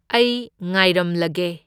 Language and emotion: Manipuri, neutral